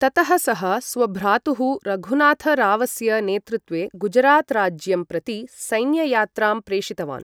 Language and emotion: Sanskrit, neutral